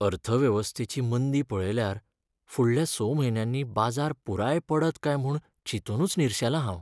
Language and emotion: Goan Konkani, sad